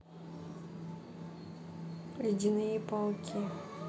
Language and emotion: Russian, neutral